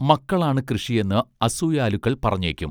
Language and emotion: Malayalam, neutral